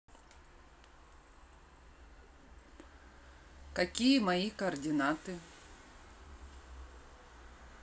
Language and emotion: Russian, neutral